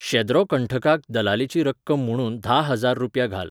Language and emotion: Goan Konkani, neutral